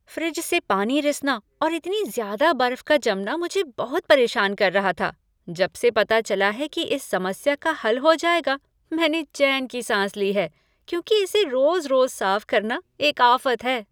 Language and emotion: Hindi, happy